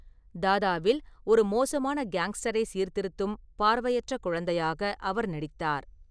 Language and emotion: Tamil, neutral